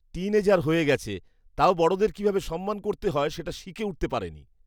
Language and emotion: Bengali, disgusted